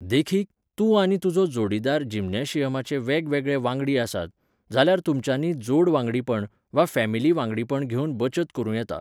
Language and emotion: Goan Konkani, neutral